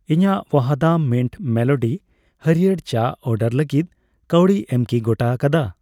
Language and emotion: Santali, neutral